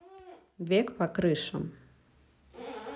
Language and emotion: Russian, neutral